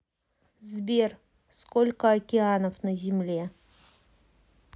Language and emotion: Russian, neutral